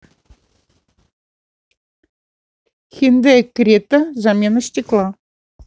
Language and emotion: Russian, neutral